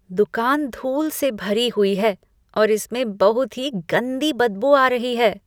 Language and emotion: Hindi, disgusted